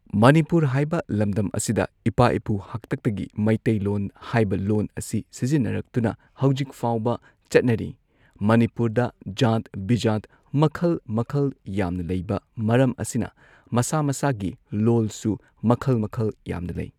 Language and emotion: Manipuri, neutral